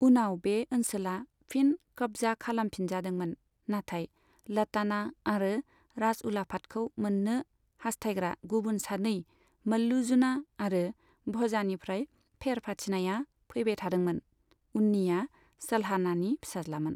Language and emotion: Bodo, neutral